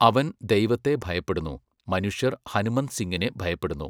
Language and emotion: Malayalam, neutral